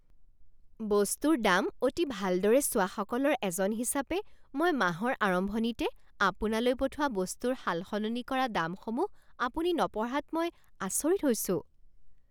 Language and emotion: Assamese, surprised